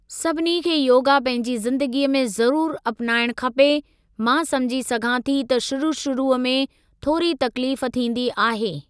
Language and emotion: Sindhi, neutral